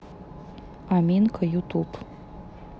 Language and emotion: Russian, neutral